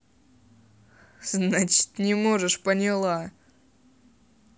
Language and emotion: Russian, angry